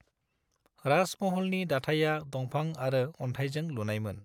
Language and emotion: Bodo, neutral